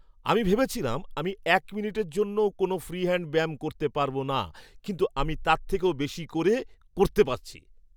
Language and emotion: Bengali, surprised